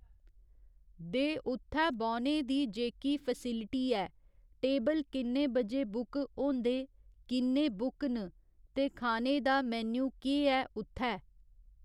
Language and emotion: Dogri, neutral